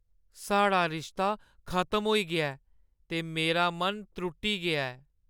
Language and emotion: Dogri, sad